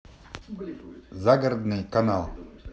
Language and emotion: Russian, neutral